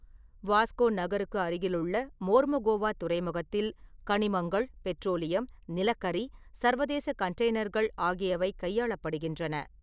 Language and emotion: Tamil, neutral